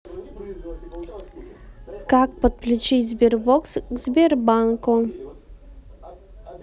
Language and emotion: Russian, neutral